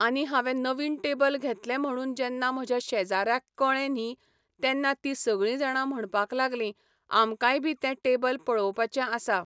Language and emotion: Goan Konkani, neutral